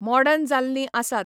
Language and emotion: Goan Konkani, neutral